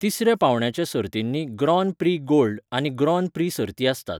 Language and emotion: Goan Konkani, neutral